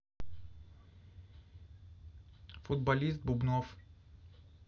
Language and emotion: Russian, neutral